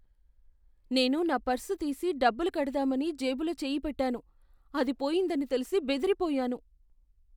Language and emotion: Telugu, fearful